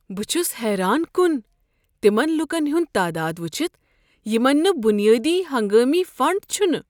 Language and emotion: Kashmiri, surprised